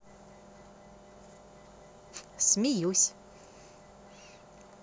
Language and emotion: Russian, positive